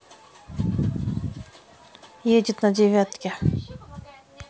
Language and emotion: Russian, neutral